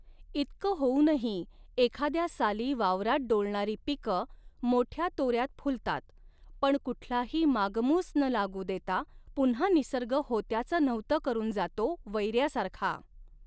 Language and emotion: Marathi, neutral